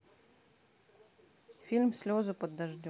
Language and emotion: Russian, neutral